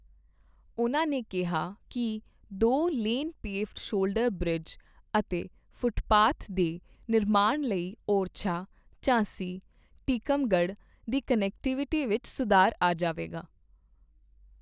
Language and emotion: Punjabi, neutral